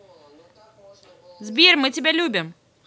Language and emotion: Russian, positive